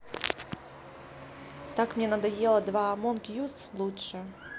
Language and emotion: Russian, neutral